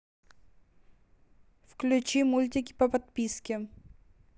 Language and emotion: Russian, neutral